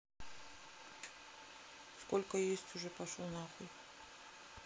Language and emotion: Russian, neutral